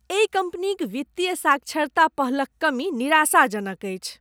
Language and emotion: Maithili, disgusted